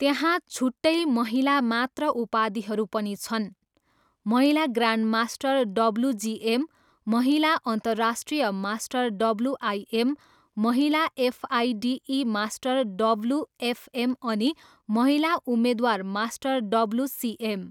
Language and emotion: Nepali, neutral